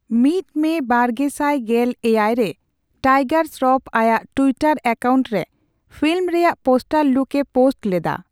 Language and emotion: Santali, neutral